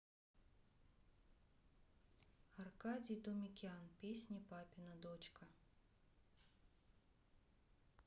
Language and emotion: Russian, neutral